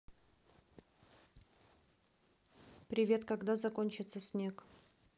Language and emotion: Russian, neutral